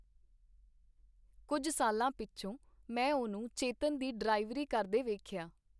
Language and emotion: Punjabi, neutral